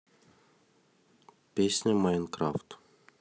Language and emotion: Russian, neutral